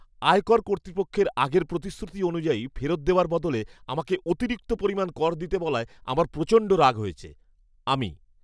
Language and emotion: Bengali, angry